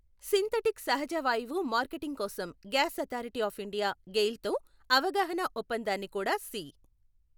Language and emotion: Telugu, neutral